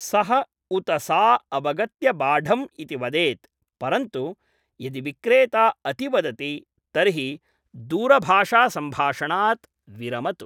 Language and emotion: Sanskrit, neutral